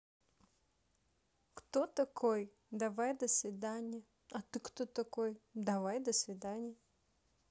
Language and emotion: Russian, neutral